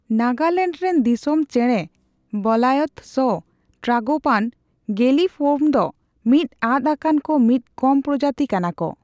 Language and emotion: Santali, neutral